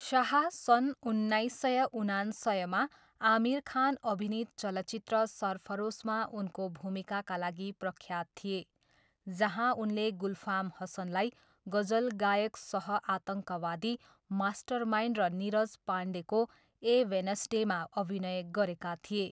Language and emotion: Nepali, neutral